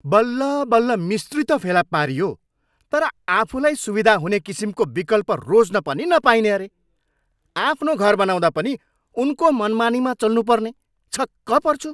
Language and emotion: Nepali, angry